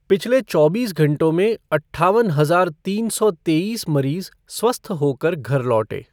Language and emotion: Hindi, neutral